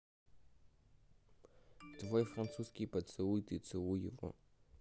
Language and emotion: Russian, neutral